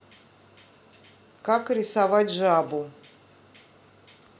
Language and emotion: Russian, neutral